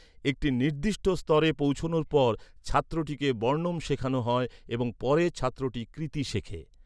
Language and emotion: Bengali, neutral